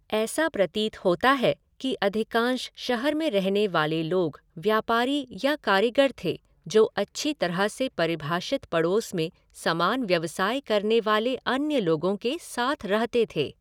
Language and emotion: Hindi, neutral